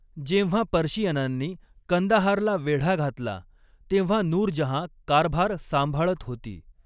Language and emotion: Marathi, neutral